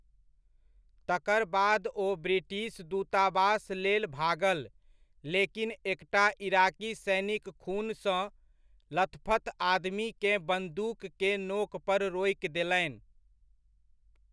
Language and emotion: Maithili, neutral